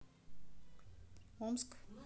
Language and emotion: Russian, neutral